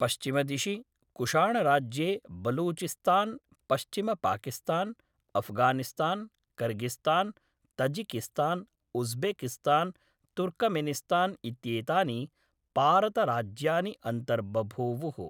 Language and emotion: Sanskrit, neutral